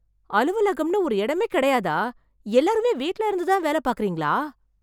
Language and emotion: Tamil, surprised